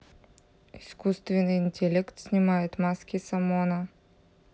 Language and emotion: Russian, neutral